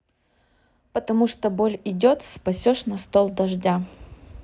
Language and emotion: Russian, neutral